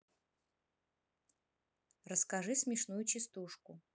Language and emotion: Russian, neutral